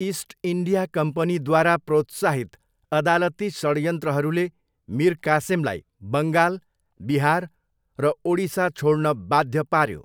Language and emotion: Nepali, neutral